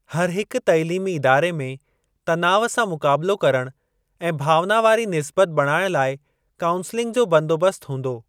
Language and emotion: Sindhi, neutral